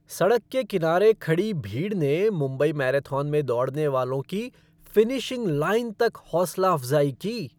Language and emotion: Hindi, happy